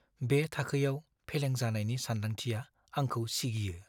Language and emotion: Bodo, fearful